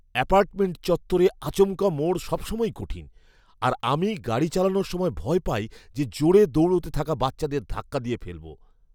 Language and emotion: Bengali, fearful